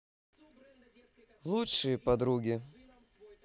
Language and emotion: Russian, positive